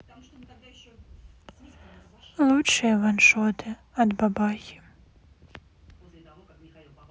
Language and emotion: Russian, sad